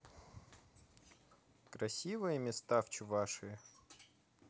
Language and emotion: Russian, positive